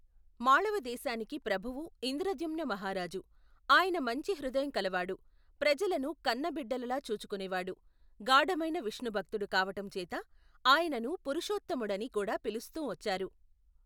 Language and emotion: Telugu, neutral